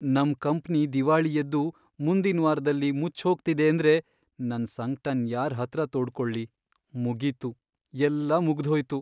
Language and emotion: Kannada, sad